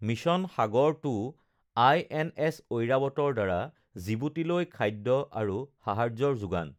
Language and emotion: Assamese, neutral